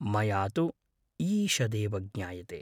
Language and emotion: Sanskrit, neutral